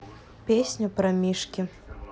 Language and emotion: Russian, neutral